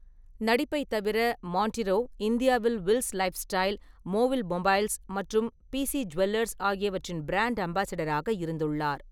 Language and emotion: Tamil, neutral